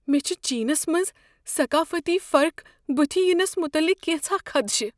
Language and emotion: Kashmiri, fearful